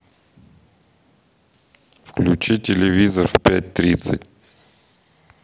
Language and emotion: Russian, neutral